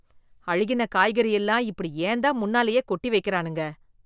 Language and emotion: Tamil, disgusted